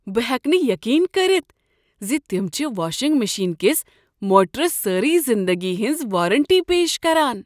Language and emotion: Kashmiri, surprised